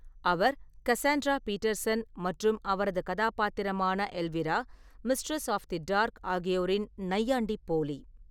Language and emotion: Tamil, neutral